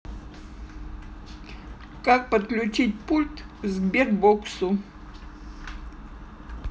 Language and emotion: Russian, neutral